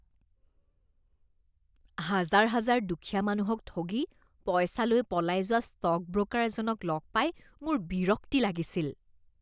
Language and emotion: Assamese, disgusted